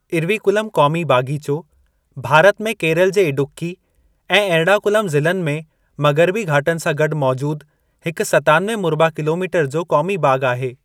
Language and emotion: Sindhi, neutral